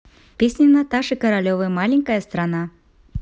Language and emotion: Russian, neutral